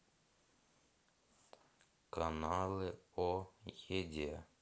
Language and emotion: Russian, neutral